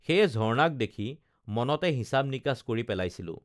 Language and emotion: Assamese, neutral